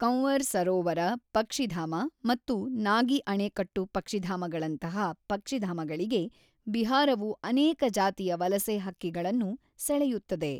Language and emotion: Kannada, neutral